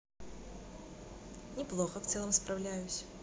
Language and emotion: Russian, positive